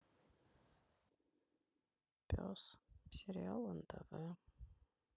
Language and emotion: Russian, sad